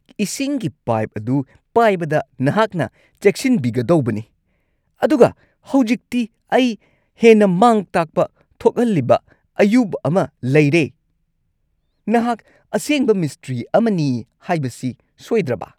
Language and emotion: Manipuri, angry